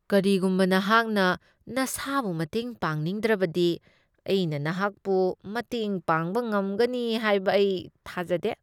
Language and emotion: Manipuri, disgusted